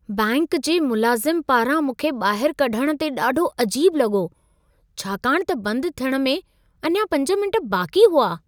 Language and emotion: Sindhi, surprised